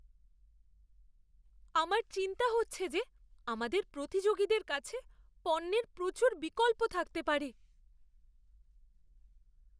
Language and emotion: Bengali, fearful